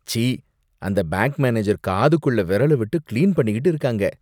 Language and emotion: Tamil, disgusted